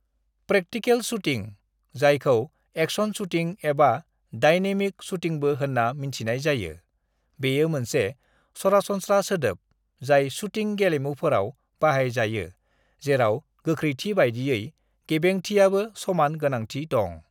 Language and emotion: Bodo, neutral